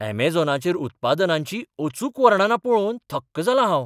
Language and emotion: Goan Konkani, surprised